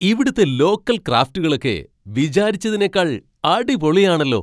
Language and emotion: Malayalam, surprised